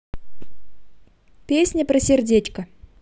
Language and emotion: Russian, positive